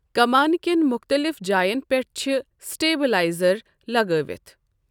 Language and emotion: Kashmiri, neutral